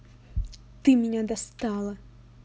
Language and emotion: Russian, angry